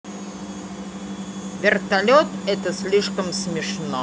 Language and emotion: Russian, neutral